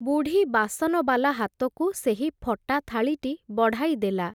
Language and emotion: Odia, neutral